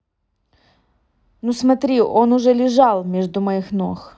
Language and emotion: Russian, neutral